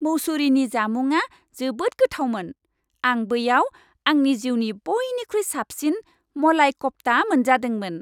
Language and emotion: Bodo, happy